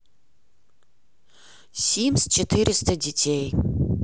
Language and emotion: Russian, neutral